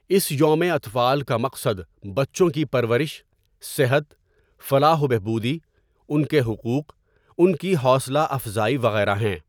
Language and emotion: Urdu, neutral